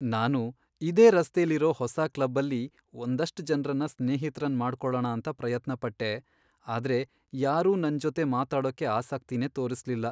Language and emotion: Kannada, sad